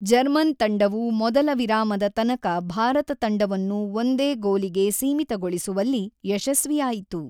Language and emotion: Kannada, neutral